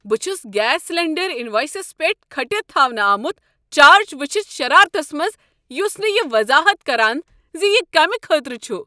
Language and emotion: Kashmiri, angry